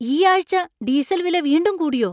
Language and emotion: Malayalam, surprised